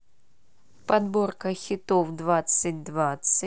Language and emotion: Russian, neutral